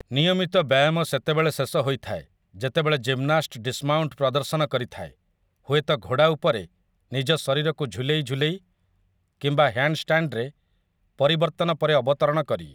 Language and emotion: Odia, neutral